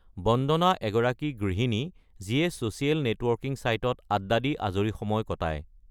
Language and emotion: Assamese, neutral